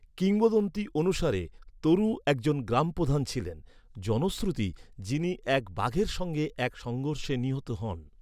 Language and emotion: Bengali, neutral